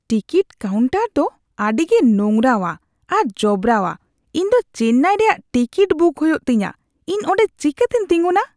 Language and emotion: Santali, disgusted